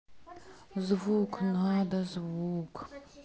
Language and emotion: Russian, sad